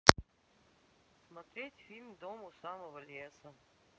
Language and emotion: Russian, sad